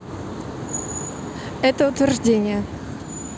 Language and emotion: Russian, neutral